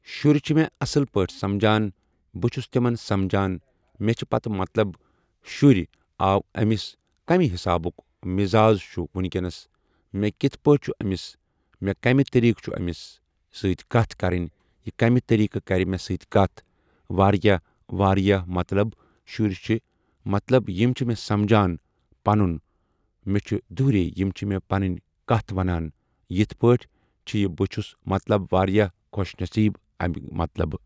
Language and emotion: Kashmiri, neutral